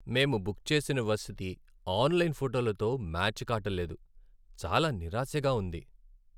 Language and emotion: Telugu, sad